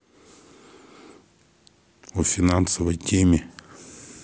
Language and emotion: Russian, neutral